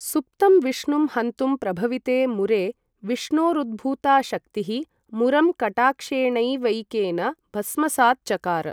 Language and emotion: Sanskrit, neutral